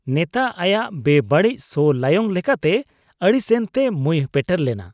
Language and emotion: Santali, disgusted